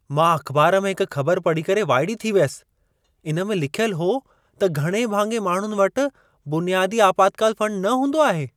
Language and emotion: Sindhi, surprised